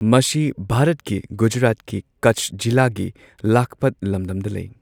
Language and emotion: Manipuri, neutral